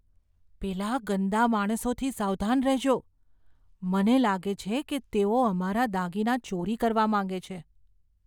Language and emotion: Gujarati, fearful